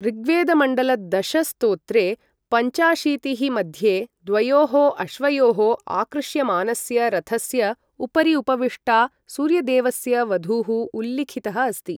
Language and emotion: Sanskrit, neutral